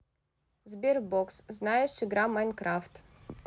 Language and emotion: Russian, neutral